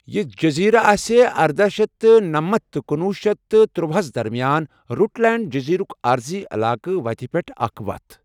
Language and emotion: Kashmiri, neutral